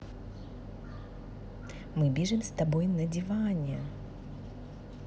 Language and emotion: Russian, positive